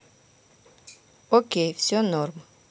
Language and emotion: Russian, neutral